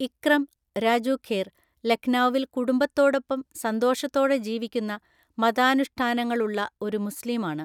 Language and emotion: Malayalam, neutral